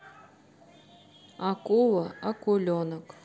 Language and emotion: Russian, neutral